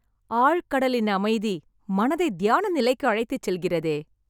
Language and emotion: Tamil, happy